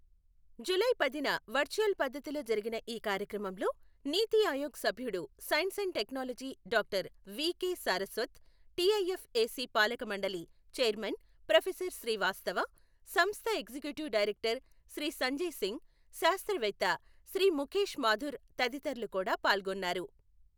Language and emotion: Telugu, neutral